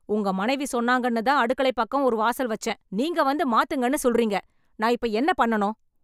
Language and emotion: Tamil, angry